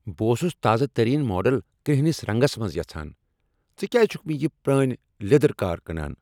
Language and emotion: Kashmiri, angry